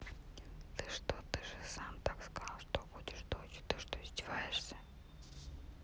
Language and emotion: Russian, neutral